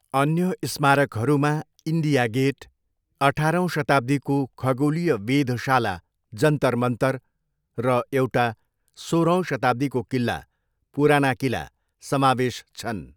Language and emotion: Nepali, neutral